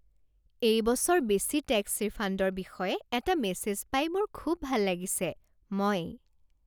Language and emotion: Assamese, happy